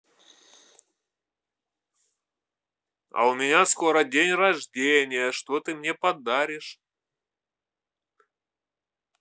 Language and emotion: Russian, neutral